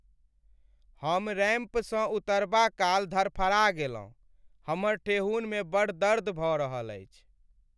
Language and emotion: Maithili, sad